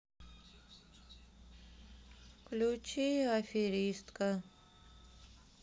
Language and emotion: Russian, sad